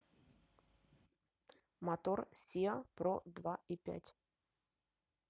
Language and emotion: Russian, neutral